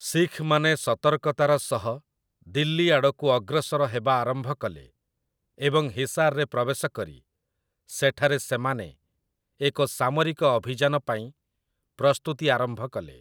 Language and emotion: Odia, neutral